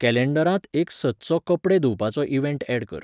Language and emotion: Goan Konkani, neutral